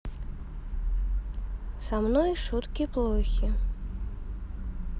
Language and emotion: Russian, neutral